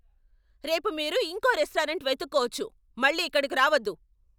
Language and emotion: Telugu, angry